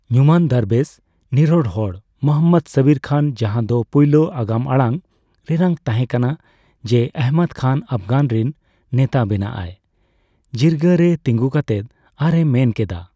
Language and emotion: Santali, neutral